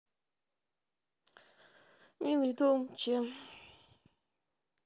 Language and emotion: Russian, sad